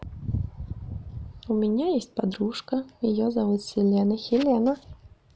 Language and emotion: Russian, neutral